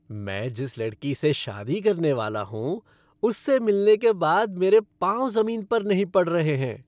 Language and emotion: Hindi, happy